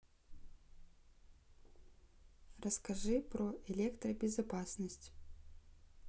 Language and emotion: Russian, neutral